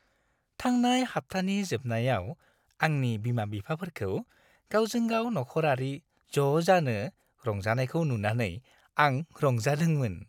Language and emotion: Bodo, happy